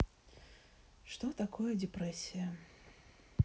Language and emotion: Russian, sad